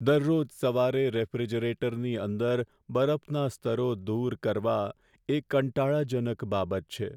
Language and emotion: Gujarati, sad